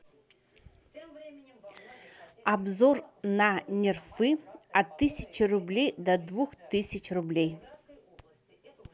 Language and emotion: Russian, neutral